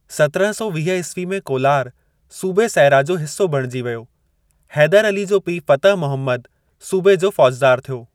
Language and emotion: Sindhi, neutral